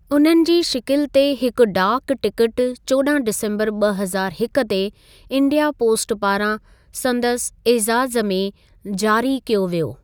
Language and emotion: Sindhi, neutral